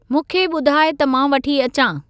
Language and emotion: Sindhi, neutral